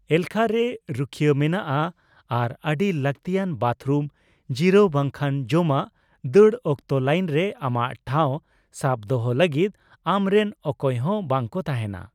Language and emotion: Santali, neutral